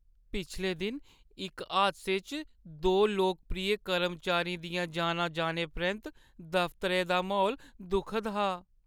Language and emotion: Dogri, sad